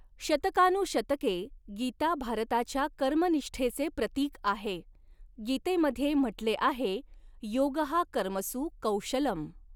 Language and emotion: Marathi, neutral